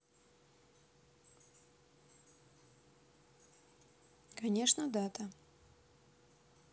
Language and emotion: Russian, neutral